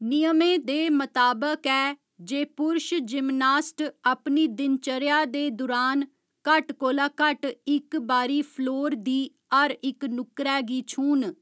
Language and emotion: Dogri, neutral